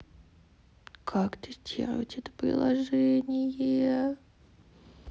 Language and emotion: Russian, sad